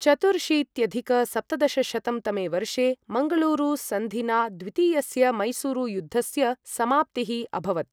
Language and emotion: Sanskrit, neutral